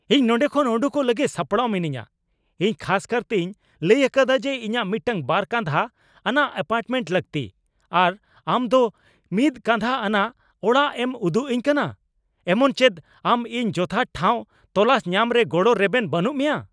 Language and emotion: Santali, angry